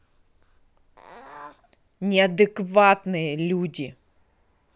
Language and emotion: Russian, angry